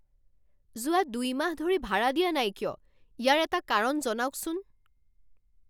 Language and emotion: Assamese, angry